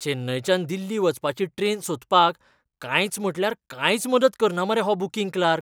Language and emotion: Goan Konkani, disgusted